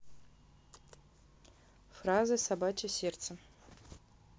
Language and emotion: Russian, neutral